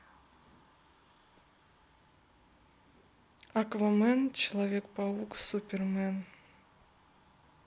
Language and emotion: Russian, neutral